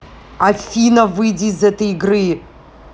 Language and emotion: Russian, angry